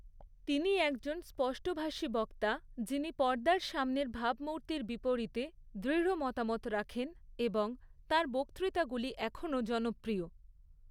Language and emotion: Bengali, neutral